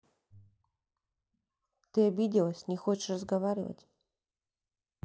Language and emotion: Russian, sad